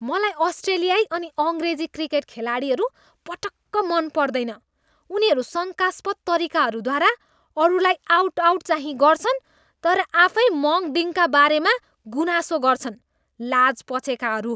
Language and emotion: Nepali, disgusted